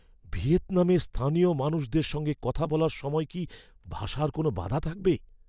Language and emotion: Bengali, fearful